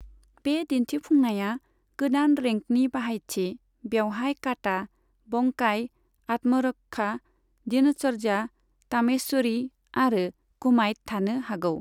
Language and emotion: Bodo, neutral